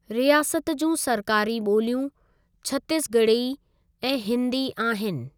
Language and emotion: Sindhi, neutral